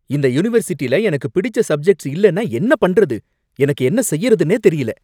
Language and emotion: Tamil, angry